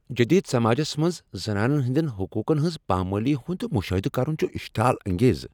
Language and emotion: Kashmiri, angry